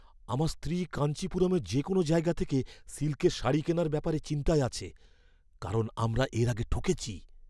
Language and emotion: Bengali, fearful